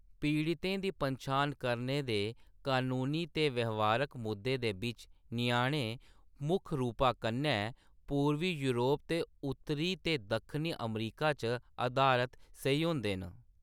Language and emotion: Dogri, neutral